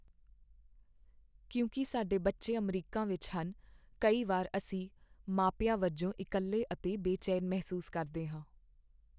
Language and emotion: Punjabi, sad